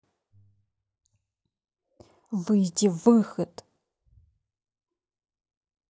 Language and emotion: Russian, angry